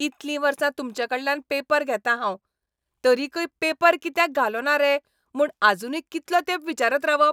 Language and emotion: Goan Konkani, angry